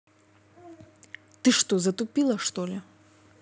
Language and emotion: Russian, angry